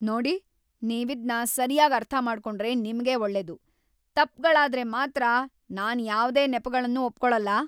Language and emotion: Kannada, angry